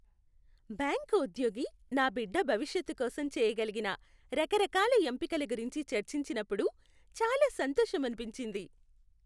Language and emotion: Telugu, happy